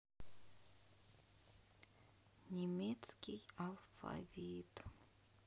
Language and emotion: Russian, sad